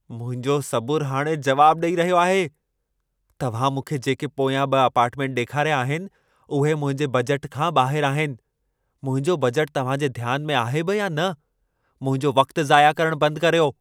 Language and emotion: Sindhi, angry